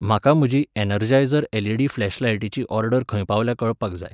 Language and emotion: Goan Konkani, neutral